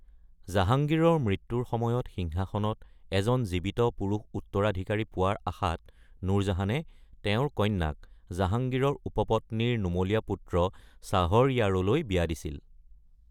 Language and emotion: Assamese, neutral